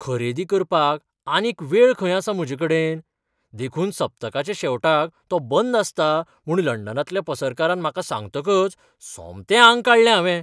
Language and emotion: Goan Konkani, surprised